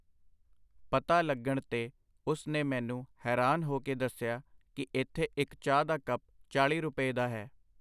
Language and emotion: Punjabi, neutral